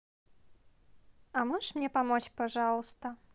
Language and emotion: Russian, neutral